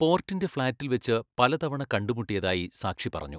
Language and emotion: Malayalam, neutral